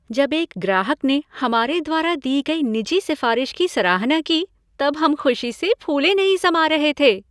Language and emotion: Hindi, happy